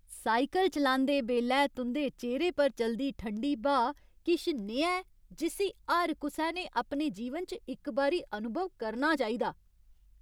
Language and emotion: Dogri, happy